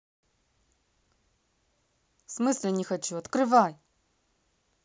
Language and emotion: Russian, angry